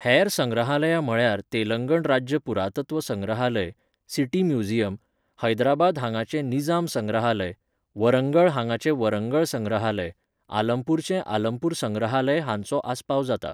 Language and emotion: Goan Konkani, neutral